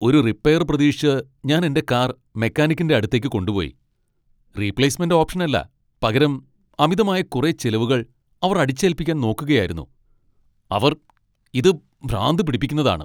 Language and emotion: Malayalam, angry